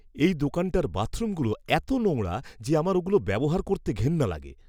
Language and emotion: Bengali, disgusted